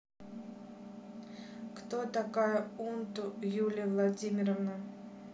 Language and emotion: Russian, neutral